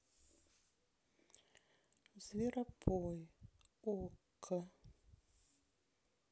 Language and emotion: Russian, neutral